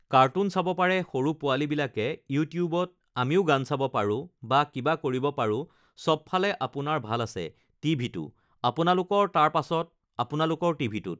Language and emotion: Assamese, neutral